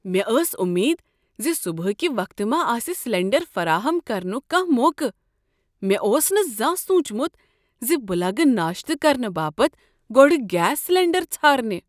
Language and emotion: Kashmiri, surprised